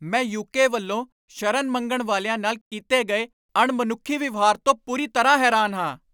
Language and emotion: Punjabi, angry